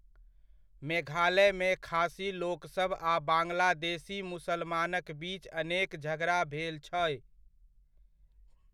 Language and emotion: Maithili, neutral